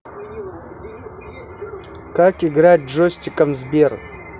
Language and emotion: Russian, neutral